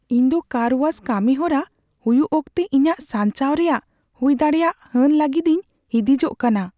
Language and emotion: Santali, fearful